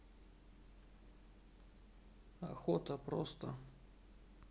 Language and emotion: Russian, neutral